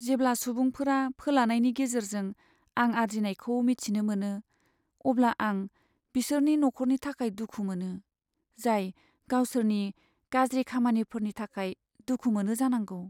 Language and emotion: Bodo, sad